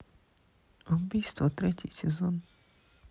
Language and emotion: Russian, neutral